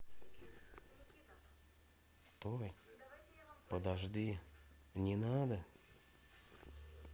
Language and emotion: Russian, neutral